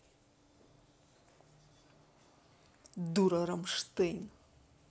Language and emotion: Russian, angry